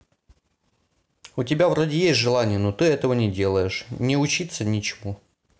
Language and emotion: Russian, sad